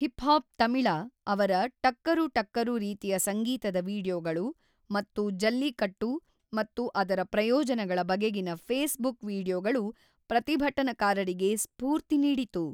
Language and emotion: Kannada, neutral